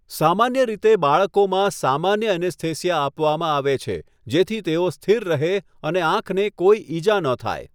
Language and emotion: Gujarati, neutral